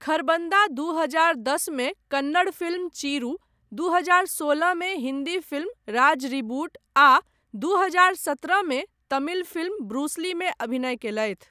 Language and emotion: Maithili, neutral